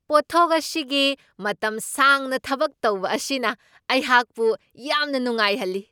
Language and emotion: Manipuri, surprised